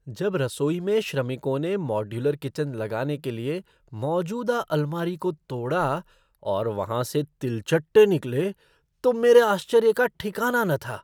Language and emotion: Hindi, surprised